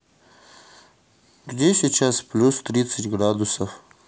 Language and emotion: Russian, neutral